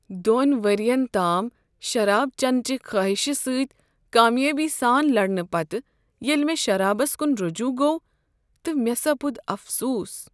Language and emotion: Kashmiri, sad